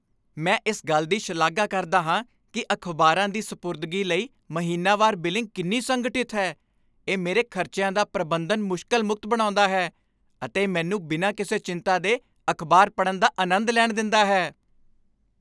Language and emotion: Punjabi, happy